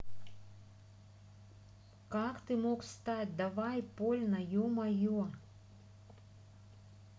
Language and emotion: Russian, angry